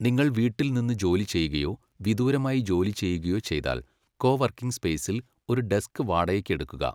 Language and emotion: Malayalam, neutral